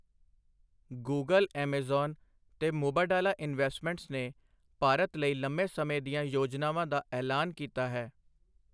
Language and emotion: Punjabi, neutral